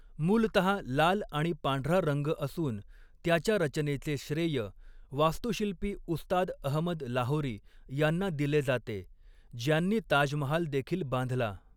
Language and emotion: Marathi, neutral